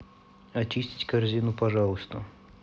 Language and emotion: Russian, neutral